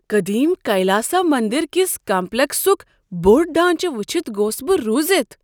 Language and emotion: Kashmiri, surprised